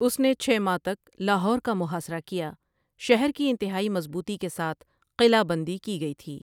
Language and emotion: Urdu, neutral